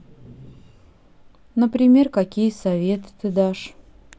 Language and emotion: Russian, sad